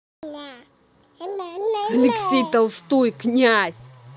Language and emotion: Russian, angry